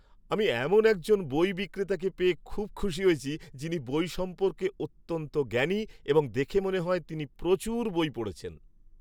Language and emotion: Bengali, happy